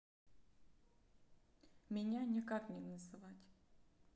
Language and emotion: Russian, neutral